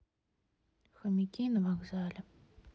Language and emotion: Russian, sad